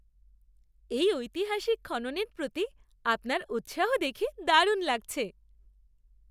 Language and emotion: Bengali, happy